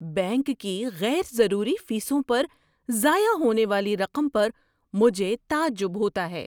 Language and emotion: Urdu, surprised